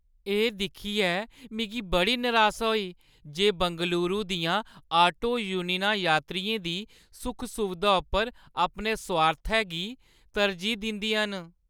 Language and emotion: Dogri, sad